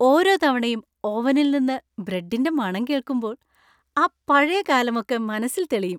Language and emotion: Malayalam, happy